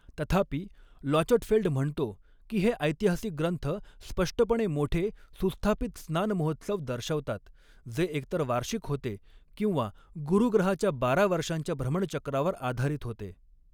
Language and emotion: Marathi, neutral